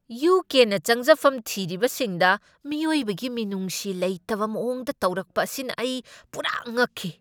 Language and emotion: Manipuri, angry